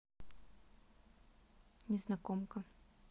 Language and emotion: Russian, neutral